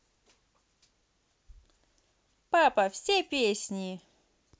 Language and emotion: Russian, positive